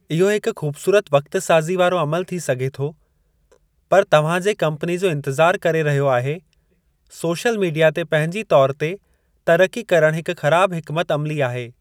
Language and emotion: Sindhi, neutral